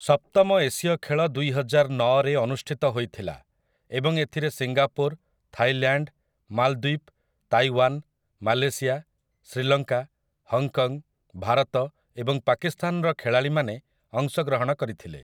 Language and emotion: Odia, neutral